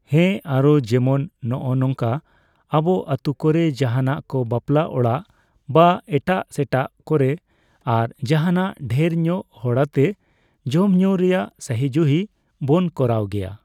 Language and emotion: Santali, neutral